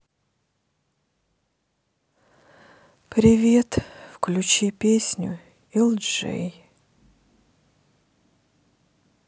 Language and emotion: Russian, sad